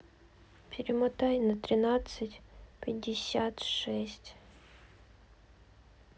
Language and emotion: Russian, sad